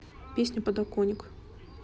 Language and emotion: Russian, neutral